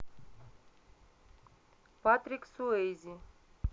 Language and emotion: Russian, neutral